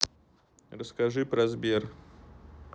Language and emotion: Russian, neutral